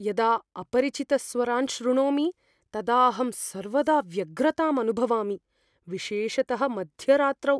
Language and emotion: Sanskrit, fearful